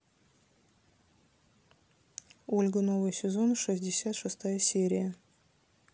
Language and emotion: Russian, neutral